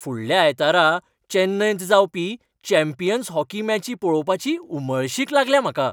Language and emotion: Goan Konkani, happy